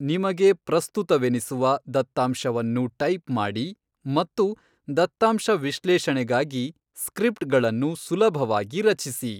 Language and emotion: Kannada, neutral